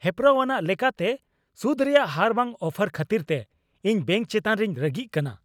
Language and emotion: Santali, angry